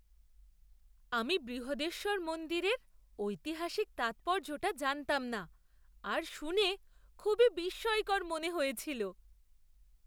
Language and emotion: Bengali, surprised